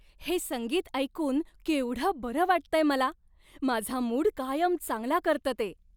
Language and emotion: Marathi, happy